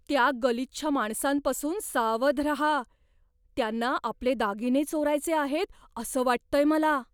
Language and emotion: Marathi, fearful